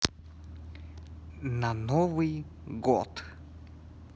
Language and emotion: Russian, neutral